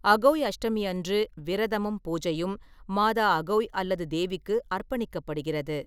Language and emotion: Tamil, neutral